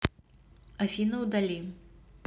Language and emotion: Russian, neutral